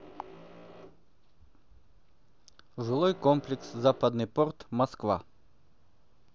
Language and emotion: Russian, neutral